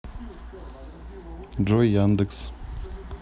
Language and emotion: Russian, neutral